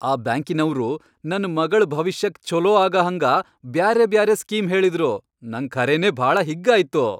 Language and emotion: Kannada, happy